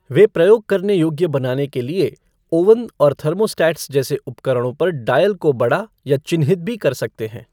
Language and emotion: Hindi, neutral